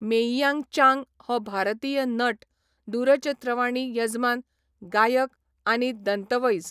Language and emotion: Goan Konkani, neutral